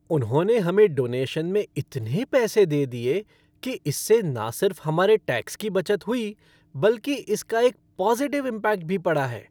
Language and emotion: Hindi, happy